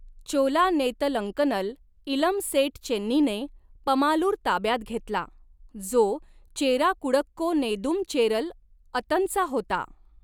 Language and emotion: Marathi, neutral